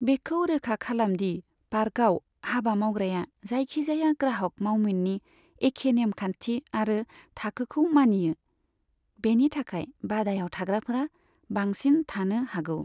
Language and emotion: Bodo, neutral